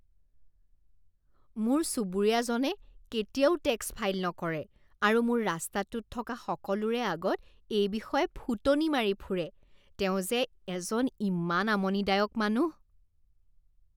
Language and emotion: Assamese, disgusted